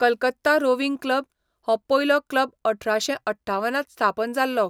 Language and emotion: Goan Konkani, neutral